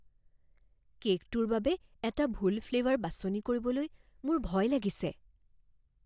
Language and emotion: Assamese, fearful